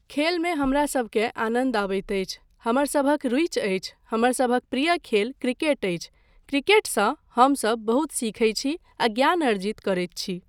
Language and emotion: Maithili, neutral